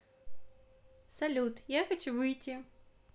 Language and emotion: Russian, positive